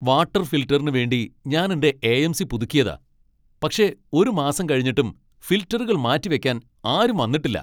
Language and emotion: Malayalam, angry